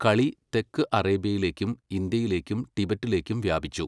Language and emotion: Malayalam, neutral